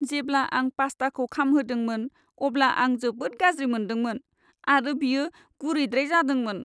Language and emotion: Bodo, sad